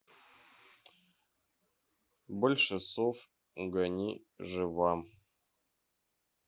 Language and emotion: Russian, neutral